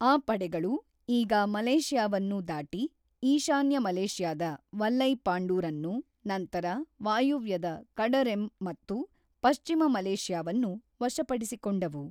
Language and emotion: Kannada, neutral